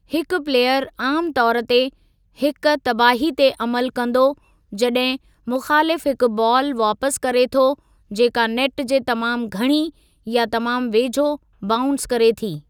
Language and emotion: Sindhi, neutral